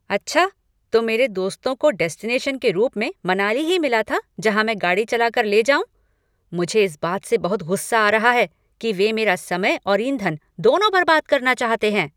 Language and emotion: Hindi, angry